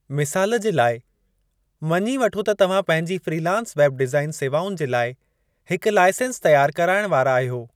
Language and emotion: Sindhi, neutral